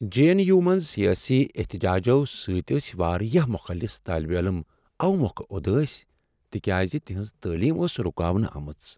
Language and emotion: Kashmiri, sad